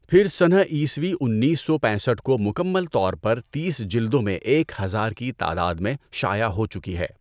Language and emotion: Urdu, neutral